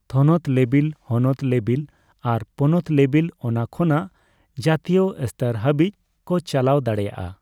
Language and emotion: Santali, neutral